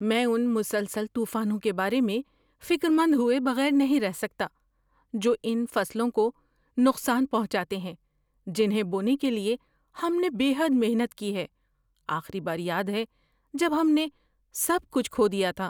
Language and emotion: Urdu, fearful